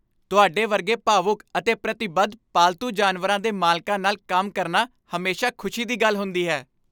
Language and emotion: Punjabi, happy